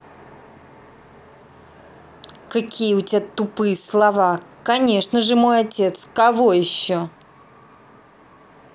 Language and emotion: Russian, angry